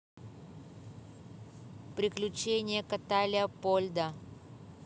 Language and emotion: Russian, neutral